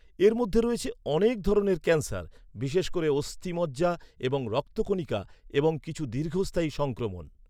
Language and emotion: Bengali, neutral